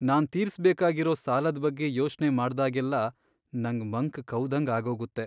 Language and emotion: Kannada, sad